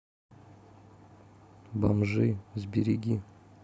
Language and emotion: Russian, neutral